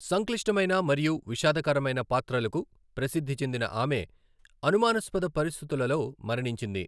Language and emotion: Telugu, neutral